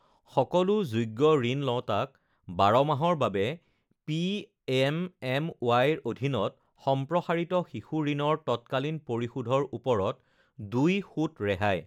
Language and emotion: Assamese, neutral